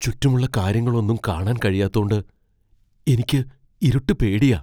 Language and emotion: Malayalam, fearful